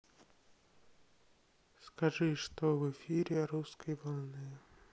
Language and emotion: Russian, sad